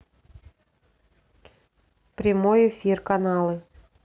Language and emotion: Russian, neutral